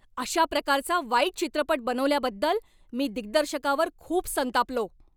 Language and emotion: Marathi, angry